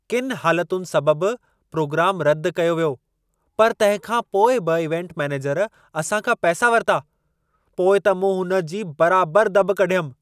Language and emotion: Sindhi, angry